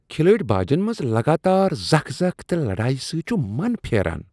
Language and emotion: Kashmiri, disgusted